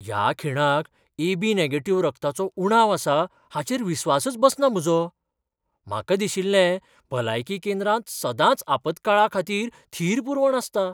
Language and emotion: Goan Konkani, surprised